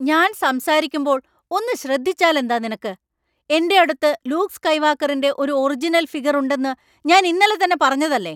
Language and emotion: Malayalam, angry